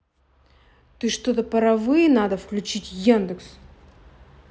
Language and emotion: Russian, angry